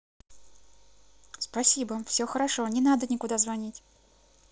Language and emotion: Russian, positive